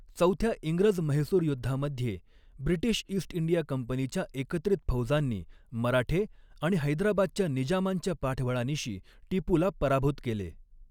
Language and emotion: Marathi, neutral